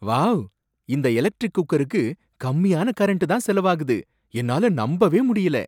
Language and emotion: Tamil, surprised